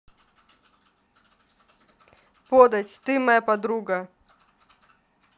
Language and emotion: Russian, neutral